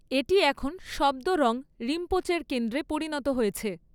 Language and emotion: Bengali, neutral